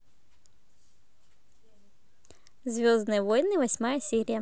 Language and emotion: Russian, positive